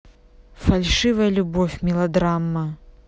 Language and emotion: Russian, neutral